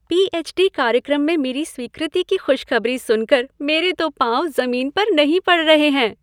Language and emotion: Hindi, happy